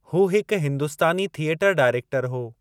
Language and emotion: Sindhi, neutral